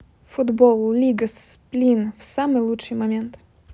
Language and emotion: Russian, neutral